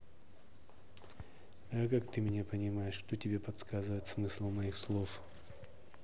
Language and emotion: Russian, neutral